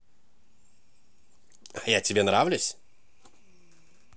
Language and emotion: Russian, positive